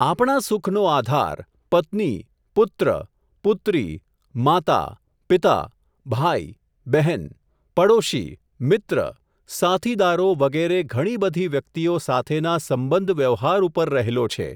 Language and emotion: Gujarati, neutral